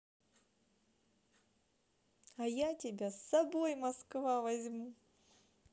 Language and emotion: Russian, positive